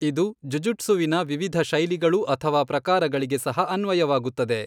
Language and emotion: Kannada, neutral